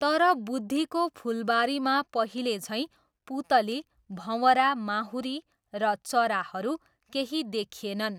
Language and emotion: Nepali, neutral